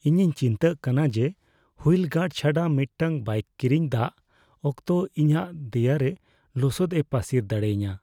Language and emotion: Santali, fearful